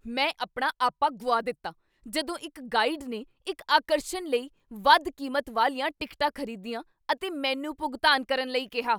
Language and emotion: Punjabi, angry